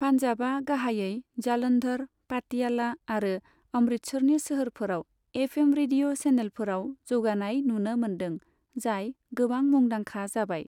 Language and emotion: Bodo, neutral